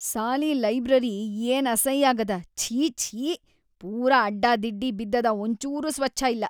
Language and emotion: Kannada, disgusted